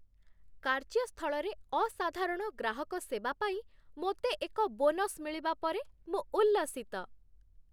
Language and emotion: Odia, happy